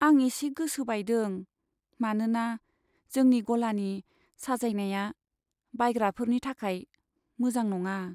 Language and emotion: Bodo, sad